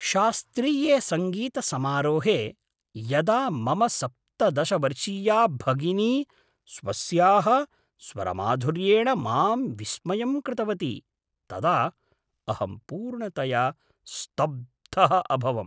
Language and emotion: Sanskrit, surprised